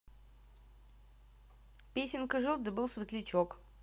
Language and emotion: Russian, neutral